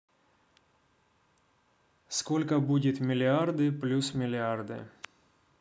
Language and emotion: Russian, neutral